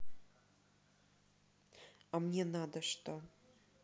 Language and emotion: Russian, neutral